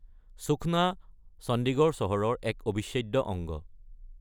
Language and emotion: Assamese, neutral